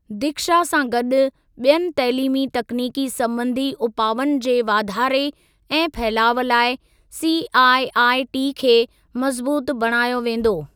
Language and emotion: Sindhi, neutral